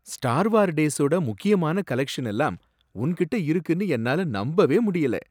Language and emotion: Tamil, surprised